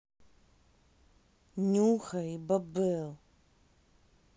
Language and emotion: Russian, angry